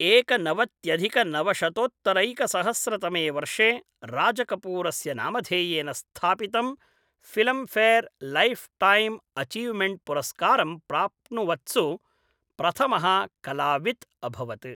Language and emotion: Sanskrit, neutral